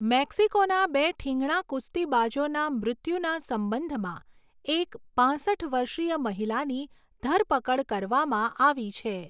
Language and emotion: Gujarati, neutral